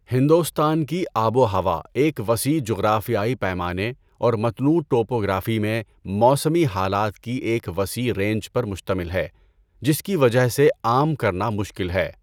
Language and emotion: Urdu, neutral